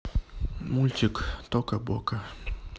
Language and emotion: Russian, neutral